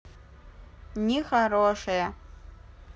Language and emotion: Russian, neutral